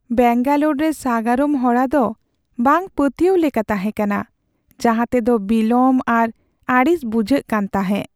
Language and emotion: Santali, sad